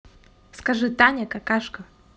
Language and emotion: Russian, neutral